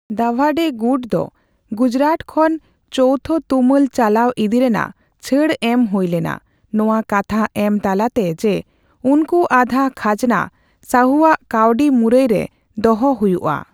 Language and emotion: Santali, neutral